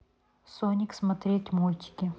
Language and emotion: Russian, neutral